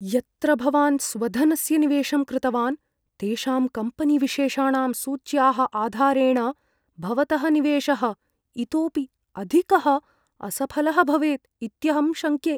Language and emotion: Sanskrit, fearful